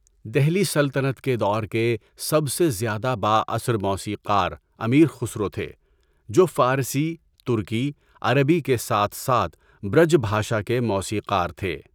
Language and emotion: Urdu, neutral